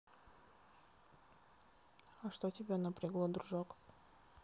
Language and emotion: Russian, neutral